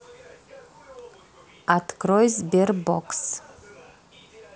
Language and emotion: Russian, neutral